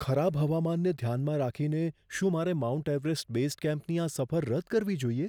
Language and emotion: Gujarati, fearful